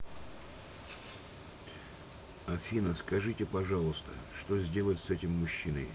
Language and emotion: Russian, neutral